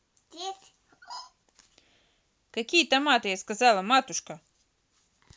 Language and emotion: Russian, angry